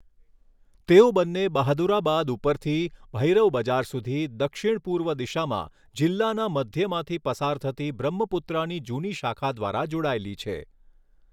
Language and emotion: Gujarati, neutral